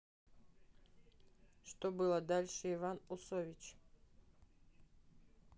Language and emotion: Russian, neutral